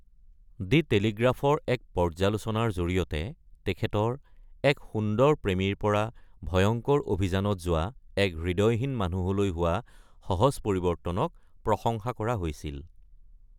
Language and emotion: Assamese, neutral